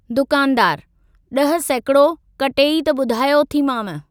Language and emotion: Sindhi, neutral